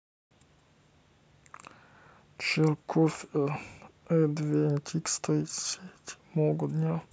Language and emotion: Russian, sad